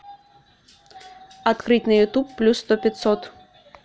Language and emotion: Russian, neutral